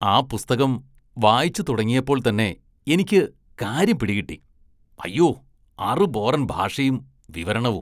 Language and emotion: Malayalam, disgusted